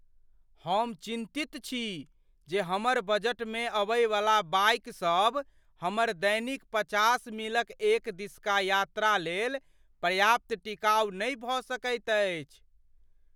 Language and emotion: Maithili, fearful